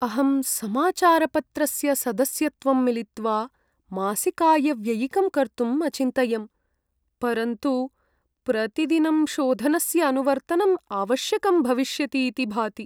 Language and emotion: Sanskrit, sad